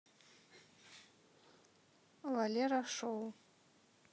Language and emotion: Russian, neutral